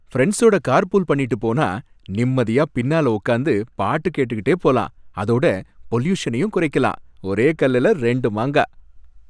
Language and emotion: Tamil, happy